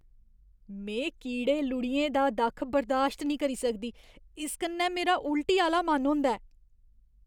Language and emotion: Dogri, disgusted